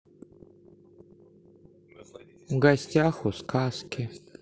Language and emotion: Russian, sad